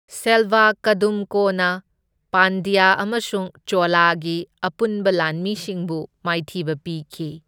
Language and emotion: Manipuri, neutral